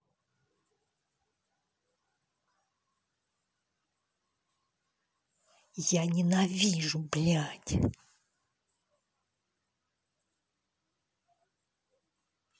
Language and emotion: Russian, angry